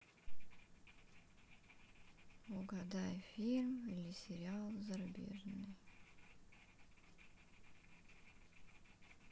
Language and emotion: Russian, sad